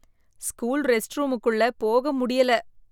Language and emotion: Tamil, disgusted